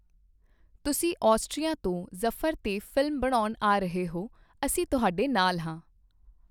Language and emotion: Punjabi, neutral